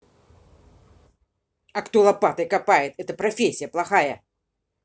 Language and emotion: Russian, angry